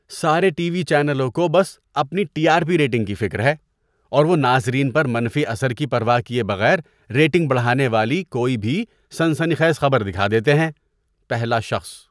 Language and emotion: Urdu, disgusted